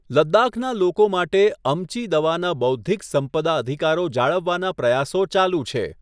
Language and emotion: Gujarati, neutral